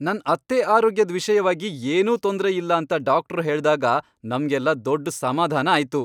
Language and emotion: Kannada, happy